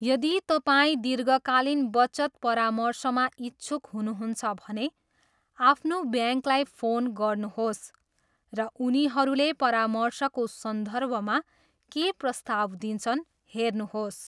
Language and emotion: Nepali, neutral